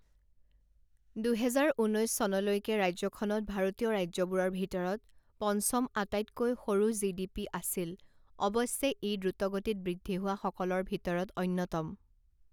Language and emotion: Assamese, neutral